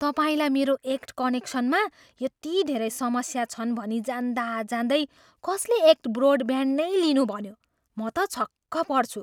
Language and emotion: Nepali, surprised